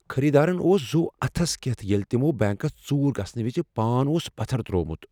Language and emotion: Kashmiri, fearful